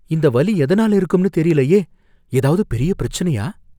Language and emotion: Tamil, fearful